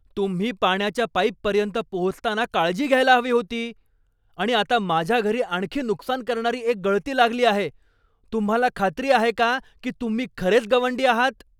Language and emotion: Marathi, angry